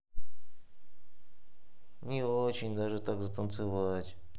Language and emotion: Russian, sad